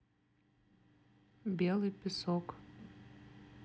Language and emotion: Russian, neutral